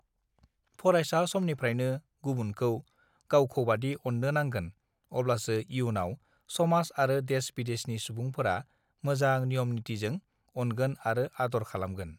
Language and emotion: Bodo, neutral